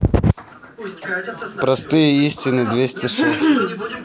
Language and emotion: Russian, neutral